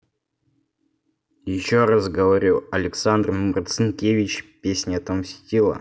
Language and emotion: Russian, angry